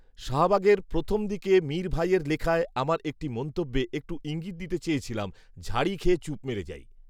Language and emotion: Bengali, neutral